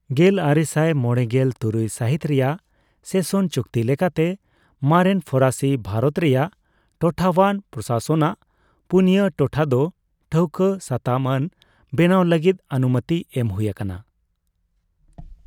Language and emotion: Santali, neutral